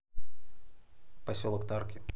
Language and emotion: Russian, neutral